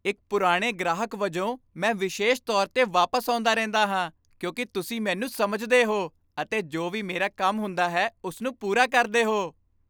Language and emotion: Punjabi, happy